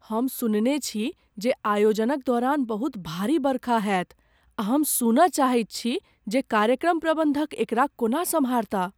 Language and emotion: Maithili, fearful